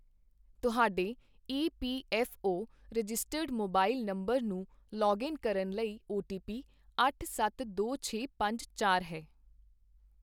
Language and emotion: Punjabi, neutral